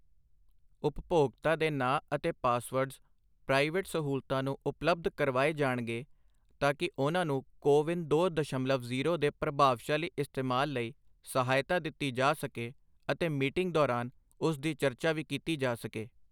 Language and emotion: Punjabi, neutral